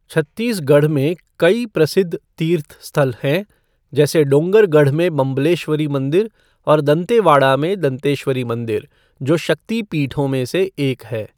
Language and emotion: Hindi, neutral